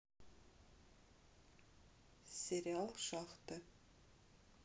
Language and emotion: Russian, neutral